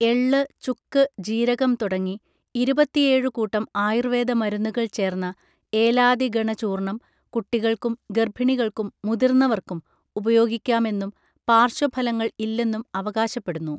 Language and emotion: Malayalam, neutral